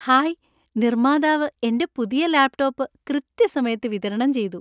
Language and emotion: Malayalam, happy